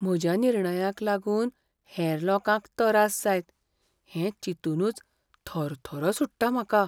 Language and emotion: Goan Konkani, fearful